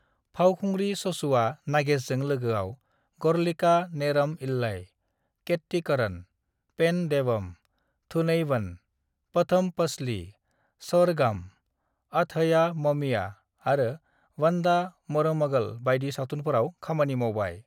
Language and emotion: Bodo, neutral